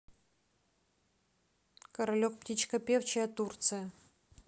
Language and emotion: Russian, neutral